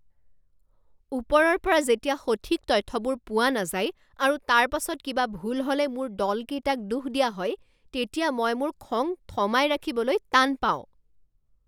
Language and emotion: Assamese, angry